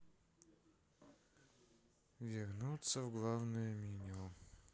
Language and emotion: Russian, sad